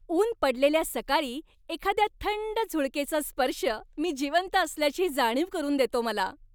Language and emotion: Marathi, happy